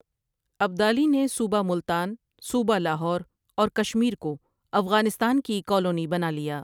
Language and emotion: Urdu, neutral